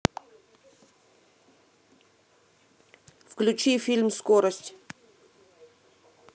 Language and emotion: Russian, neutral